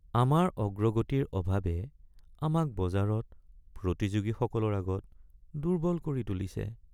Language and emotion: Assamese, sad